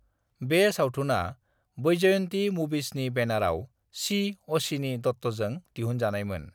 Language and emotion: Bodo, neutral